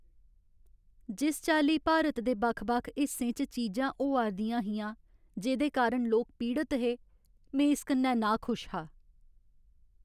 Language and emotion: Dogri, sad